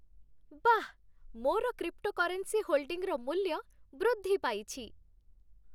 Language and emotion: Odia, happy